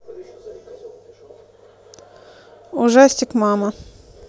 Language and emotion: Russian, neutral